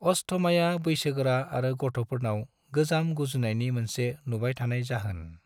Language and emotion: Bodo, neutral